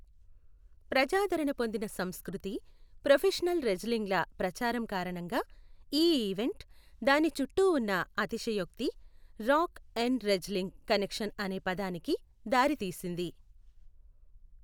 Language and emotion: Telugu, neutral